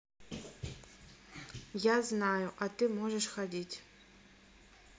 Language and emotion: Russian, neutral